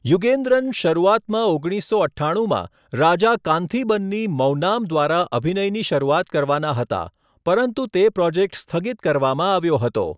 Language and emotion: Gujarati, neutral